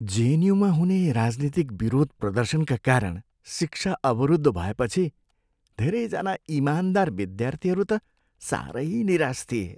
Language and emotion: Nepali, sad